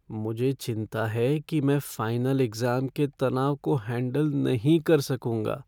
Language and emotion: Hindi, fearful